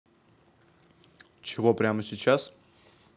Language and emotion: Russian, neutral